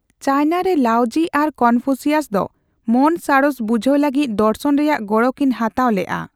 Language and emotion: Santali, neutral